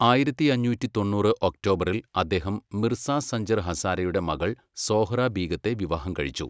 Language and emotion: Malayalam, neutral